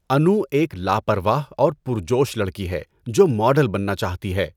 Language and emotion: Urdu, neutral